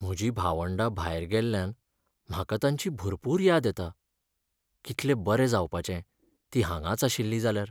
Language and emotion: Goan Konkani, sad